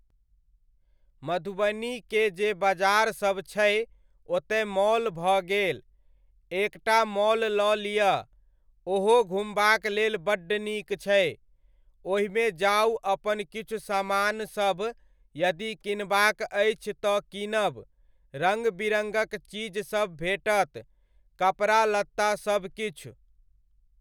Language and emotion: Maithili, neutral